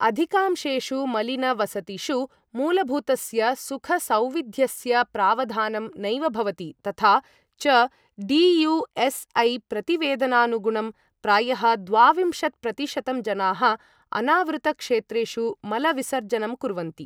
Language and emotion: Sanskrit, neutral